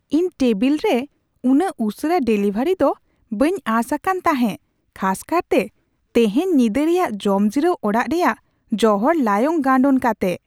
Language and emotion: Santali, surprised